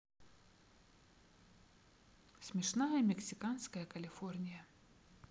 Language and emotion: Russian, neutral